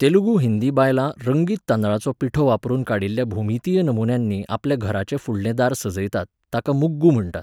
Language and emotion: Goan Konkani, neutral